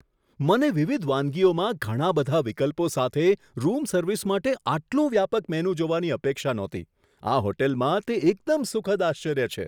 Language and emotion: Gujarati, surprised